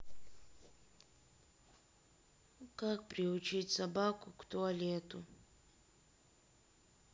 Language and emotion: Russian, sad